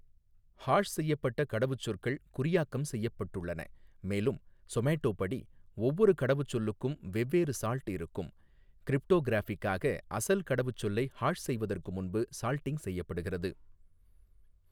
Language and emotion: Tamil, neutral